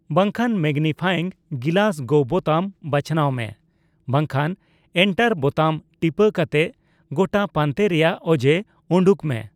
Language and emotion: Santali, neutral